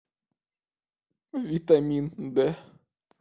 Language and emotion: Russian, sad